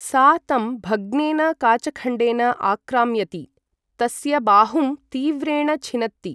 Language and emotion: Sanskrit, neutral